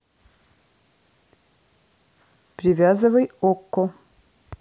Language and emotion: Russian, neutral